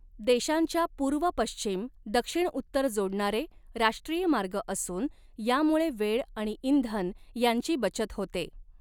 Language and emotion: Marathi, neutral